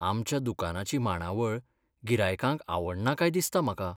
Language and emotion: Goan Konkani, sad